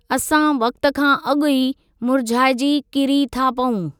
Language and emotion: Sindhi, neutral